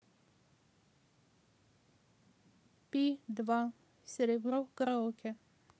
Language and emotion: Russian, neutral